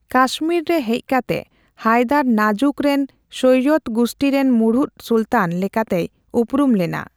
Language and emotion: Santali, neutral